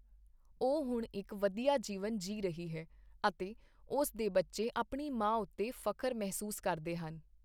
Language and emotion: Punjabi, neutral